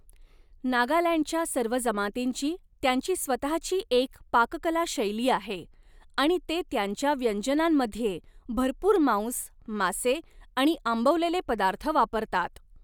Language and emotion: Marathi, neutral